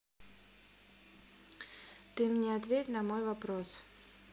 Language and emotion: Russian, neutral